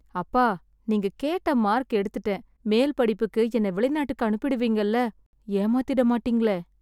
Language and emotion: Tamil, sad